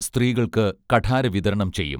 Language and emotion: Malayalam, neutral